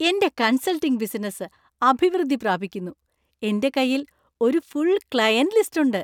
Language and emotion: Malayalam, happy